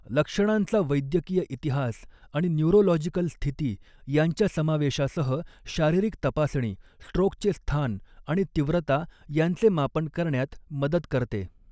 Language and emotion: Marathi, neutral